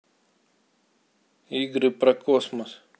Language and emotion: Russian, neutral